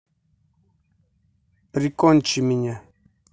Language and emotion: Russian, neutral